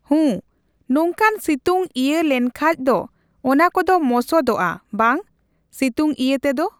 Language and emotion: Santali, neutral